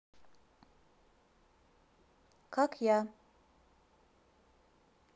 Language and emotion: Russian, neutral